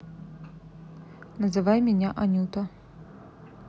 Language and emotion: Russian, neutral